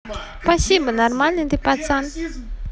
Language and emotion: Russian, positive